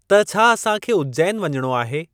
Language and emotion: Sindhi, neutral